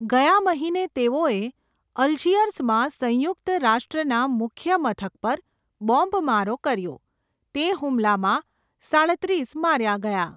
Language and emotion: Gujarati, neutral